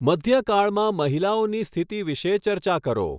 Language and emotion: Gujarati, neutral